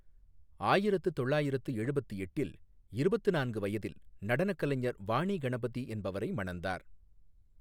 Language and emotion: Tamil, neutral